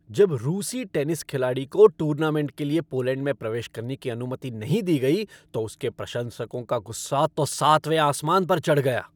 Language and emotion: Hindi, angry